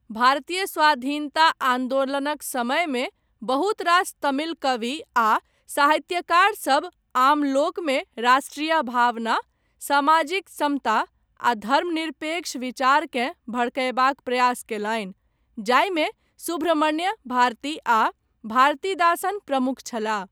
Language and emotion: Maithili, neutral